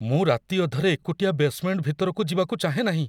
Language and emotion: Odia, fearful